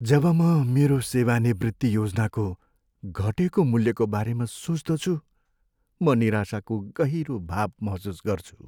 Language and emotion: Nepali, sad